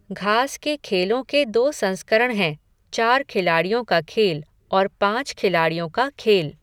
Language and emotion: Hindi, neutral